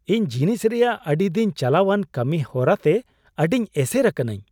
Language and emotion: Santali, surprised